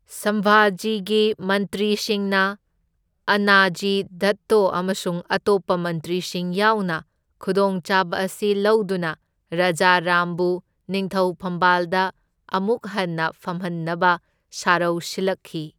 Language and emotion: Manipuri, neutral